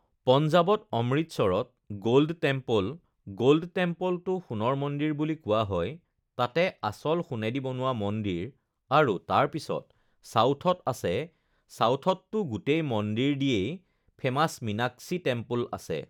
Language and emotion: Assamese, neutral